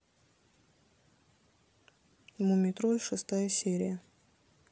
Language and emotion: Russian, neutral